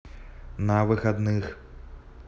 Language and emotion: Russian, neutral